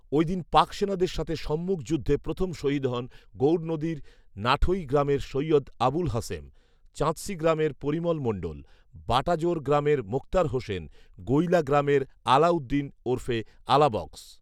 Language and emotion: Bengali, neutral